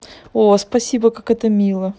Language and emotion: Russian, positive